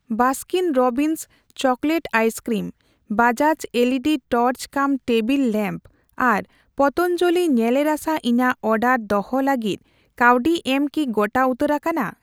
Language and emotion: Santali, neutral